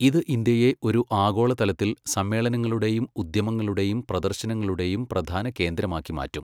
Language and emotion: Malayalam, neutral